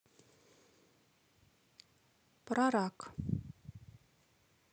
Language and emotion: Russian, neutral